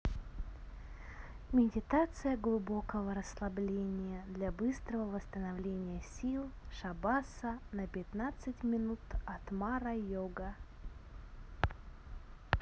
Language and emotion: Russian, neutral